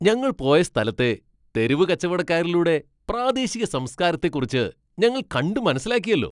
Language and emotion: Malayalam, happy